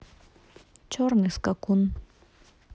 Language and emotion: Russian, neutral